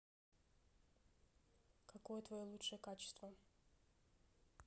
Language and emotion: Russian, neutral